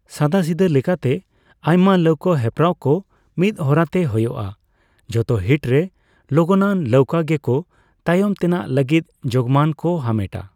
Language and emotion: Santali, neutral